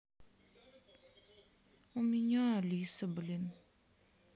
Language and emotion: Russian, sad